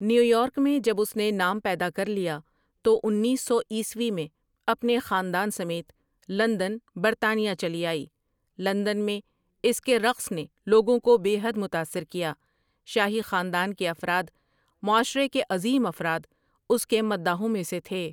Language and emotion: Urdu, neutral